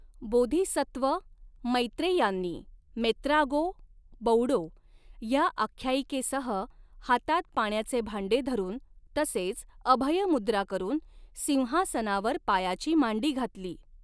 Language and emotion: Marathi, neutral